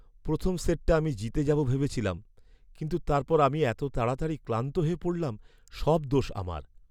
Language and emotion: Bengali, sad